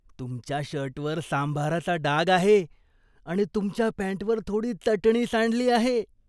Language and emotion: Marathi, disgusted